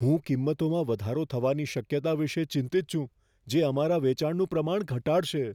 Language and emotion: Gujarati, fearful